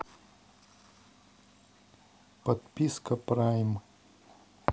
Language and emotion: Russian, neutral